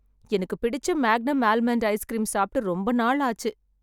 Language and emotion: Tamil, sad